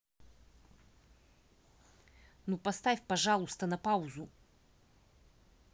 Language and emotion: Russian, angry